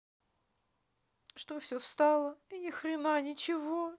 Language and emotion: Russian, sad